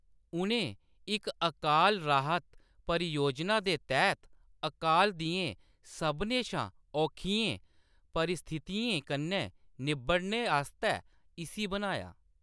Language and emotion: Dogri, neutral